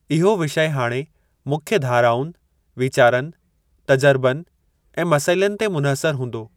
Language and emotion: Sindhi, neutral